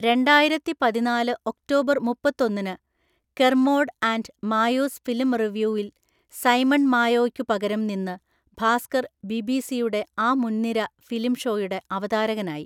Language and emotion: Malayalam, neutral